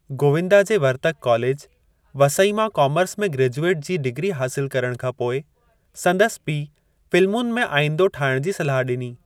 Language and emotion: Sindhi, neutral